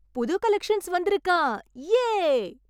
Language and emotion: Tamil, happy